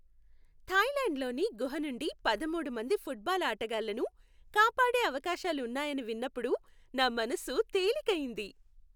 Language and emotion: Telugu, happy